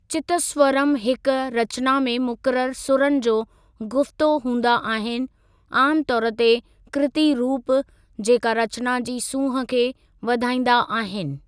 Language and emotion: Sindhi, neutral